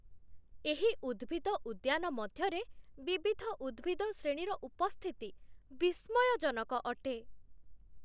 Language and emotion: Odia, surprised